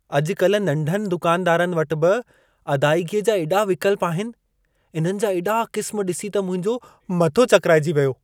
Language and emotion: Sindhi, surprised